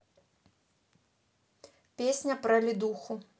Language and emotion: Russian, neutral